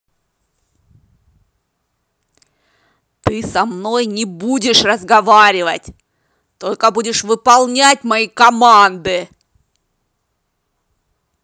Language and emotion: Russian, angry